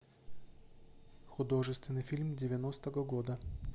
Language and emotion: Russian, neutral